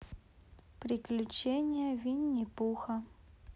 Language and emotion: Russian, neutral